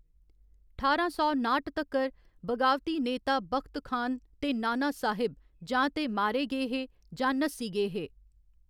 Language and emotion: Dogri, neutral